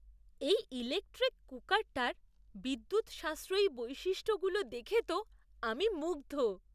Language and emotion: Bengali, surprised